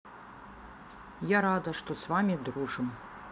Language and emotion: Russian, neutral